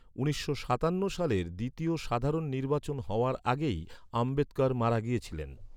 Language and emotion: Bengali, neutral